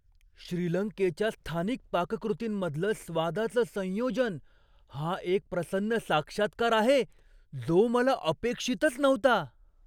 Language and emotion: Marathi, surprised